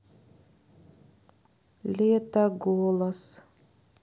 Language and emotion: Russian, sad